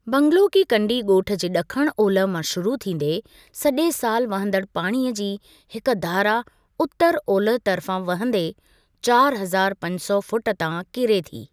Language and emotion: Sindhi, neutral